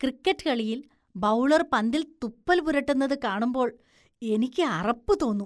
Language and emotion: Malayalam, disgusted